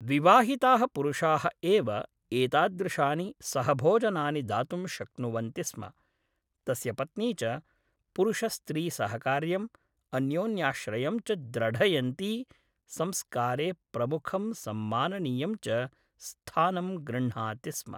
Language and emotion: Sanskrit, neutral